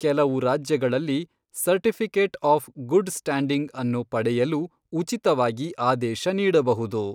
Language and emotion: Kannada, neutral